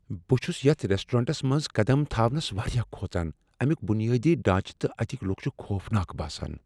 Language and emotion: Kashmiri, fearful